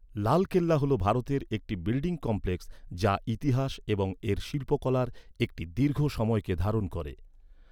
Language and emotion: Bengali, neutral